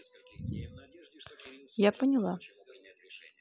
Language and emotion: Russian, neutral